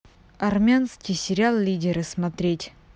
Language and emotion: Russian, neutral